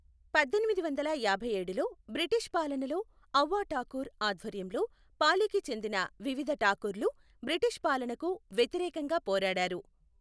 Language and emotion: Telugu, neutral